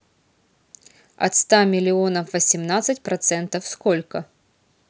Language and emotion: Russian, neutral